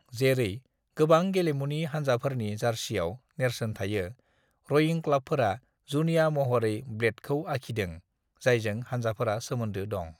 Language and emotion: Bodo, neutral